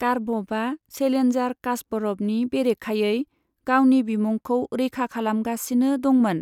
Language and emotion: Bodo, neutral